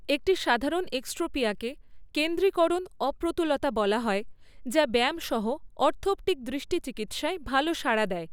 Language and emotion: Bengali, neutral